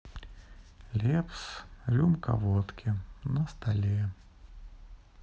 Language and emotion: Russian, sad